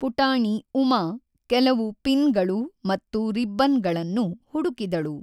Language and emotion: Kannada, neutral